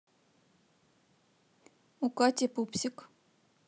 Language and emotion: Russian, neutral